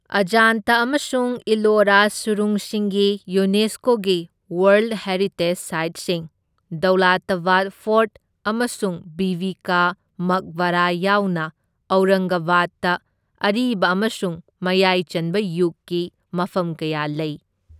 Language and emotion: Manipuri, neutral